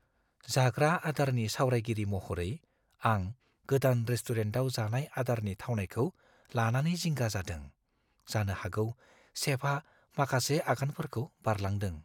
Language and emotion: Bodo, fearful